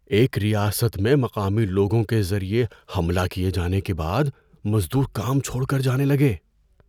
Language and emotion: Urdu, fearful